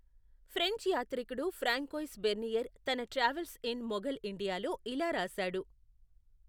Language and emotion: Telugu, neutral